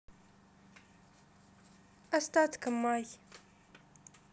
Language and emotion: Russian, sad